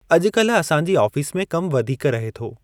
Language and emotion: Sindhi, neutral